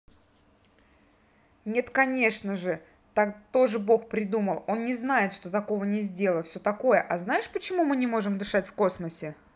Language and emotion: Russian, angry